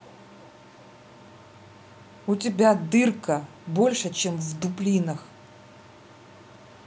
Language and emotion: Russian, angry